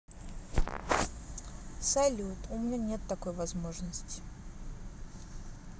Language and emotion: Russian, sad